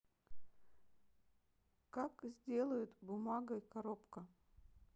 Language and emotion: Russian, neutral